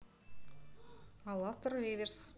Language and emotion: Russian, neutral